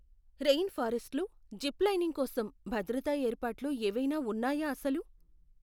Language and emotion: Telugu, fearful